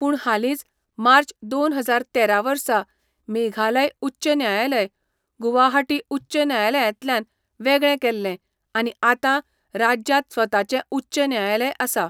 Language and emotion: Goan Konkani, neutral